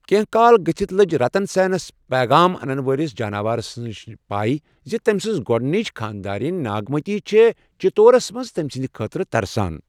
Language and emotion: Kashmiri, neutral